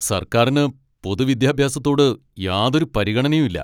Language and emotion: Malayalam, angry